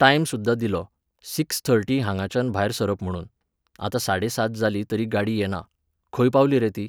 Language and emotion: Goan Konkani, neutral